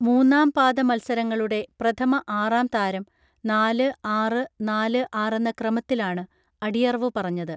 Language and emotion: Malayalam, neutral